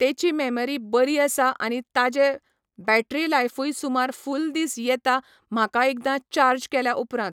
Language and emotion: Goan Konkani, neutral